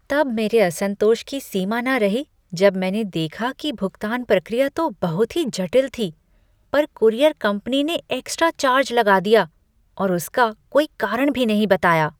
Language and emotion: Hindi, disgusted